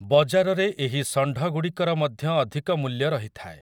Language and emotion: Odia, neutral